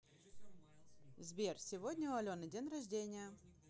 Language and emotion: Russian, positive